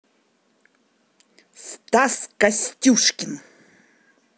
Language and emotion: Russian, angry